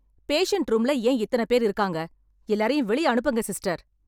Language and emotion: Tamil, angry